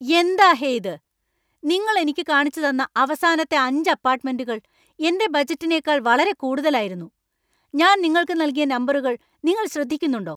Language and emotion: Malayalam, angry